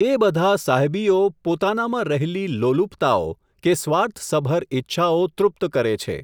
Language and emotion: Gujarati, neutral